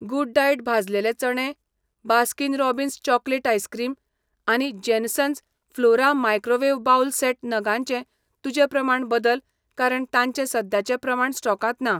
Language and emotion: Goan Konkani, neutral